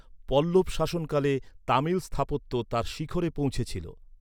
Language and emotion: Bengali, neutral